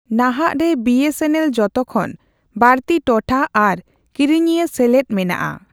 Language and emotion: Santali, neutral